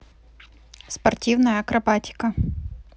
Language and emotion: Russian, neutral